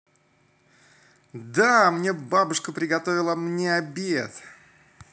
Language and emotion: Russian, positive